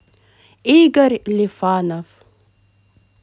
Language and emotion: Russian, positive